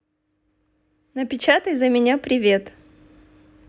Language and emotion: Russian, positive